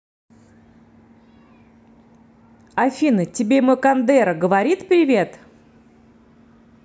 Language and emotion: Russian, neutral